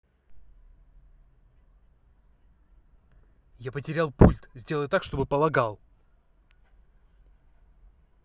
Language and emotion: Russian, angry